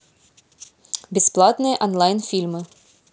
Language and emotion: Russian, neutral